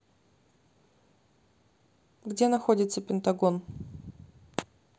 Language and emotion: Russian, neutral